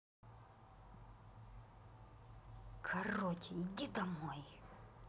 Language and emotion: Russian, angry